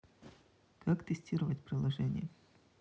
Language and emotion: Russian, neutral